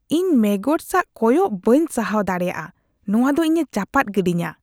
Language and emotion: Santali, disgusted